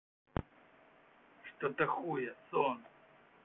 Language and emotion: Russian, angry